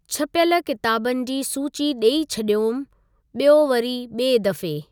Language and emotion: Sindhi, neutral